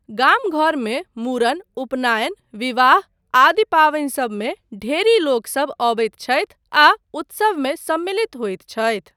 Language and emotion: Maithili, neutral